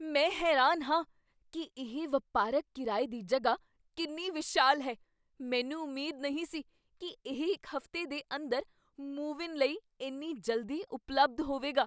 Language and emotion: Punjabi, surprised